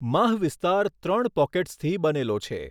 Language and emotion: Gujarati, neutral